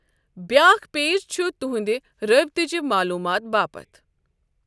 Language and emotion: Kashmiri, neutral